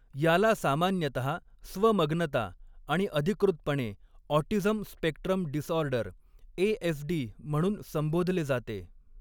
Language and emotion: Marathi, neutral